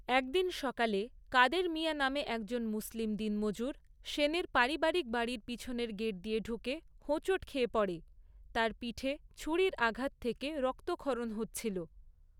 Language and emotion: Bengali, neutral